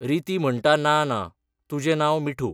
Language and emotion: Goan Konkani, neutral